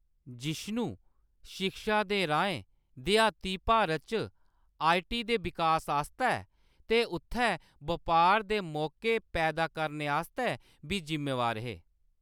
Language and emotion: Dogri, neutral